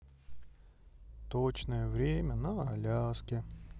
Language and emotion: Russian, sad